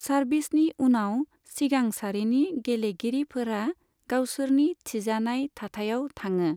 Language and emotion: Bodo, neutral